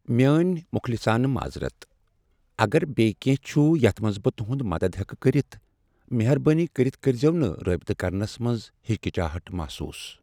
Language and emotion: Kashmiri, sad